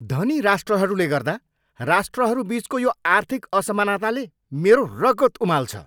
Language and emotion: Nepali, angry